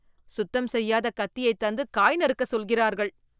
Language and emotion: Tamil, disgusted